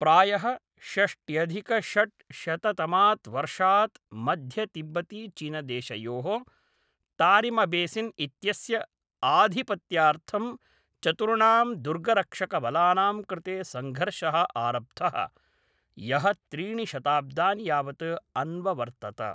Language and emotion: Sanskrit, neutral